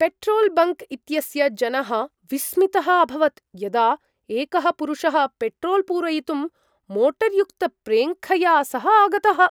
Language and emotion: Sanskrit, surprised